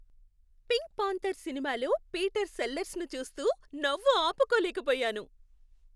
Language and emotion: Telugu, happy